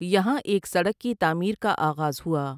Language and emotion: Urdu, neutral